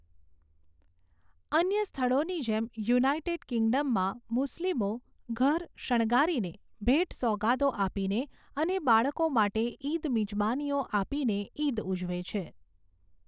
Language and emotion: Gujarati, neutral